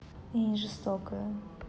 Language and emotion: Russian, neutral